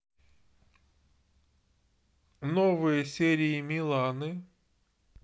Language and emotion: Russian, neutral